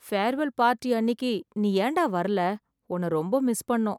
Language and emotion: Tamil, sad